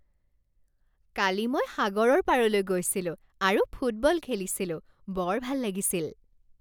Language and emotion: Assamese, happy